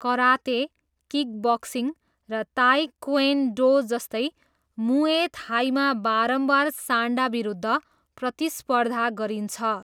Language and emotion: Nepali, neutral